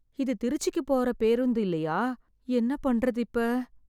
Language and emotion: Tamil, fearful